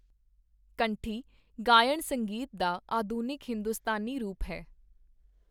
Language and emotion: Punjabi, neutral